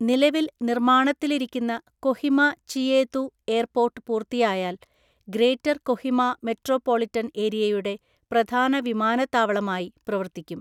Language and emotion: Malayalam, neutral